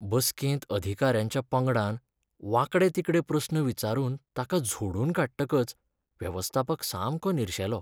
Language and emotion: Goan Konkani, sad